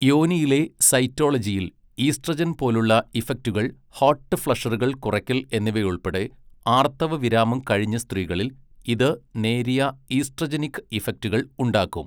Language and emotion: Malayalam, neutral